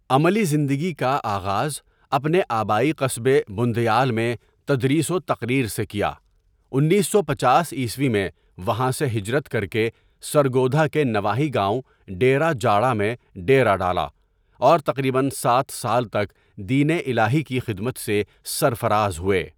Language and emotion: Urdu, neutral